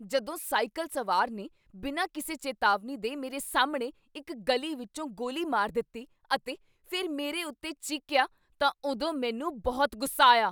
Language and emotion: Punjabi, angry